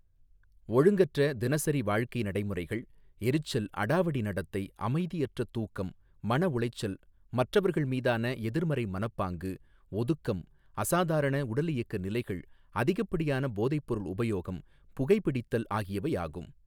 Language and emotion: Tamil, neutral